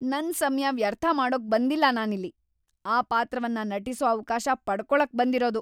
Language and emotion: Kannada, angry